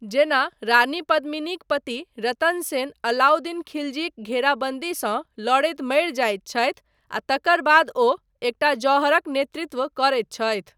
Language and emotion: Maithili, neutral